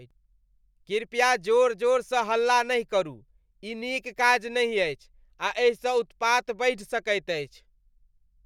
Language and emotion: Maithili, disgusted